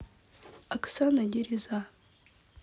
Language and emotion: Russian, neutral